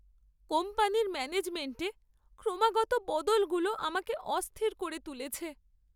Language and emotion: Bengali, sad